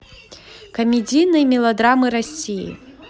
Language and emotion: Russian, positive